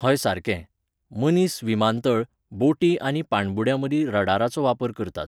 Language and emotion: Goan Konkani, neutral